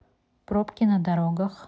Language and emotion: Russian, neutral